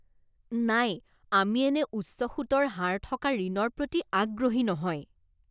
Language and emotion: Assamese, disgusted